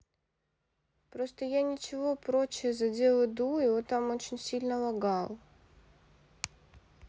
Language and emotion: Russian, sad